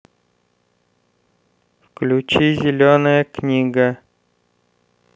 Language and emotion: Russian, neutral